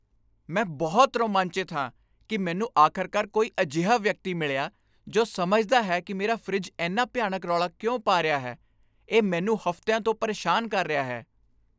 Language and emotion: Punjabi, happy